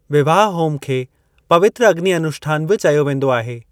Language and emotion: Sindhi, neutral